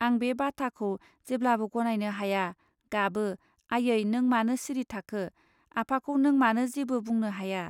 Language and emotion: Bodo, neutral